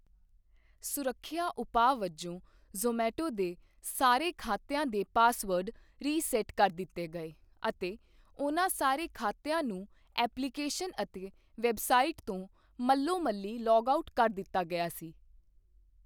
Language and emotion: Punjabi, neutral